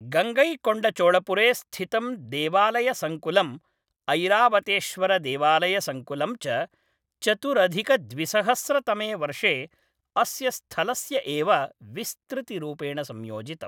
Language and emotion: Sanskrit, neutral